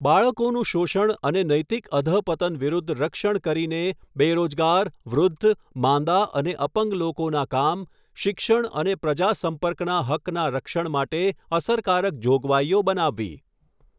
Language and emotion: Gujarati, neutral